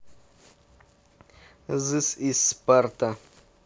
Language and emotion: Russian, neutral